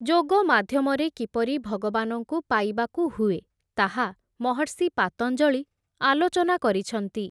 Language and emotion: Odia, neutral